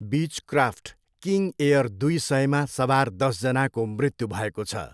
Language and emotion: Nepali, neutral